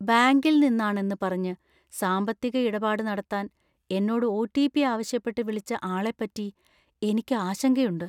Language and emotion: Malayalam, fearful